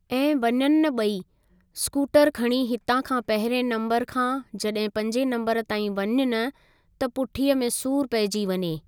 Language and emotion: Sindhi, neutral